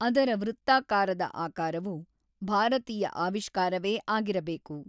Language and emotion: Kannada, neutral